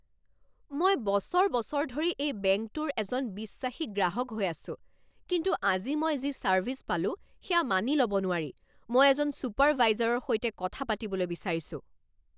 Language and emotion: Assamese, angry